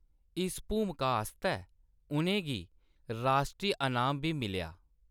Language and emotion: Dogri, neutral